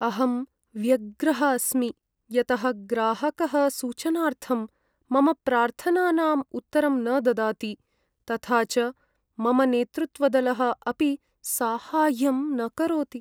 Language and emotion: Sanskrit, sad